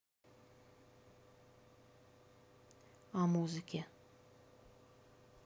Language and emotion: Russian, neutral